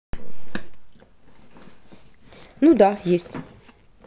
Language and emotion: Russian, neutral